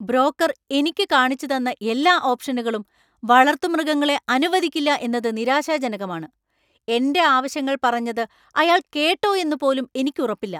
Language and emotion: Malayalam, angry